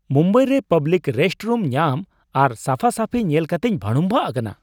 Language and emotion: Santali, surprised